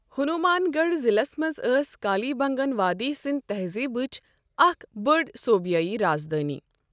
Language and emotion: Kashmiri, neutral